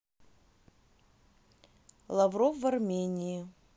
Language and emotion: Russian, neutral